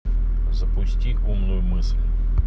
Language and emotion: Russian, neutral